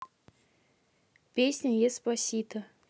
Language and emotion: Russian, neutral